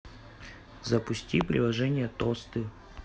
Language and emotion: Russian, neutral